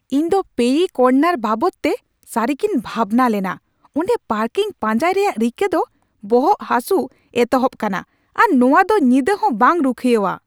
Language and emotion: Santali, angry